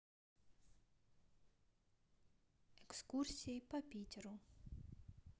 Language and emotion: Russian, neutral